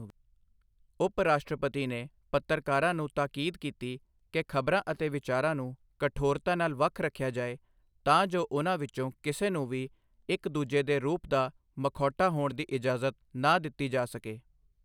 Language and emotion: Punjabi, neutral